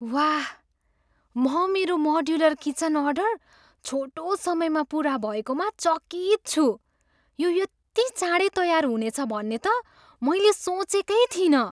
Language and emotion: Nepali, surprised